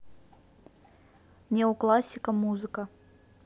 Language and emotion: Russian, neutral